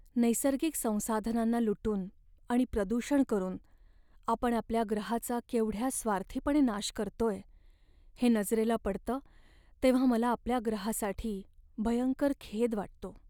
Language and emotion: Marathi, sad